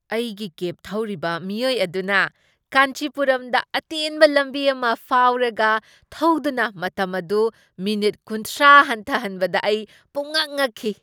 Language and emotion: Manipuri, surprised